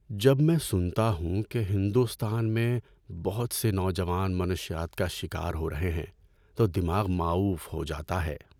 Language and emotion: Urdu, sad